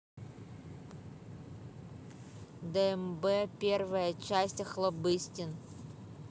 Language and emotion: Russian, neutral